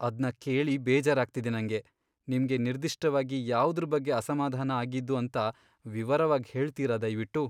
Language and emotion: Kannada, sad